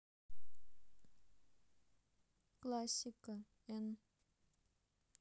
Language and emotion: Russian, neutral